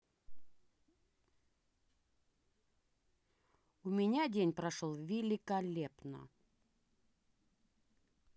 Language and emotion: Russian, positive